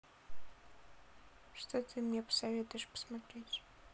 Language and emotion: Russian, neutral